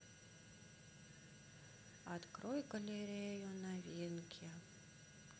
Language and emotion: Russian, sad